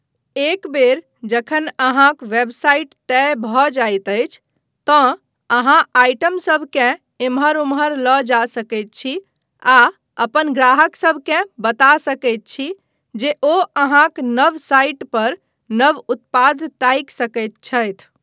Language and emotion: Maithili, neutral